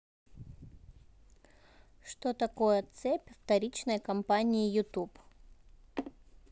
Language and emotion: Russian, neutral